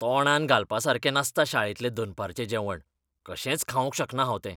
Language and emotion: Goan Konkani, disgusted